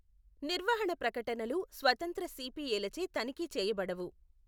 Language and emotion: Telugu, neutral